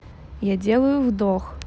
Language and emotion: Russian, neutral